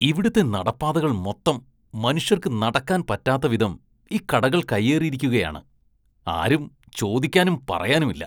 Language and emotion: Malayalam, disgusted